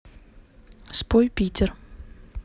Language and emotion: Russian, neutral